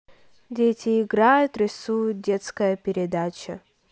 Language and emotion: Russian, neutral